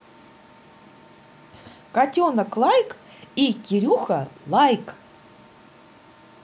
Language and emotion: Russian, positive